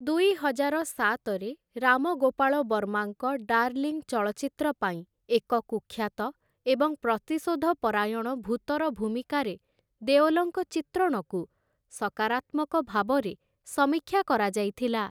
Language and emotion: Odia, neutral